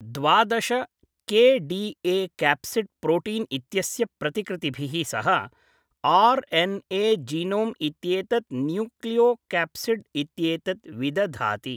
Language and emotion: Sanskrit, neutral